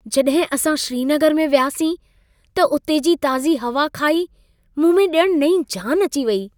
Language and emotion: Sindhi, happy